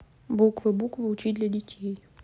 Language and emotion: Russian, neutral